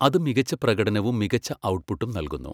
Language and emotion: Malayalam, neutral